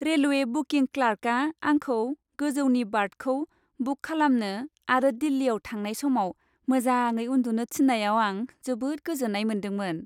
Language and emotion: Bodo, happy